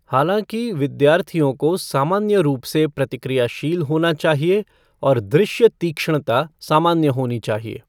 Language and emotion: Hindi, neutral